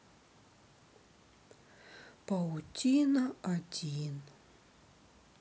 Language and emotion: Russian, sad